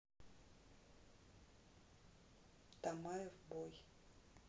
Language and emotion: Russian, neutral